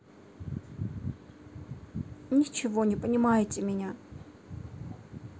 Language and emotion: Russian, sad